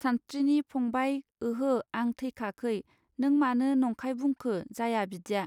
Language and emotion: Bodo, neutral